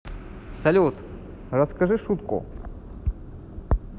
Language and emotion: Russian, positive